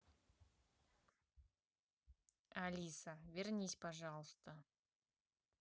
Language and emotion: Russian, neutral